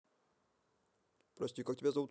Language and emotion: Russian, neutral